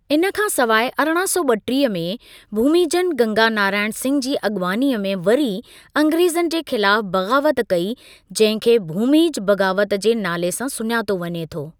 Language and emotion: Sindhi, neutral